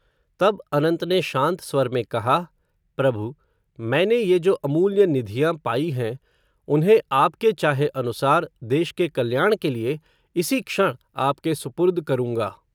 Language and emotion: Hindi, neutral